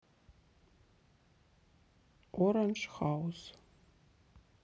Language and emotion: Russian, neutral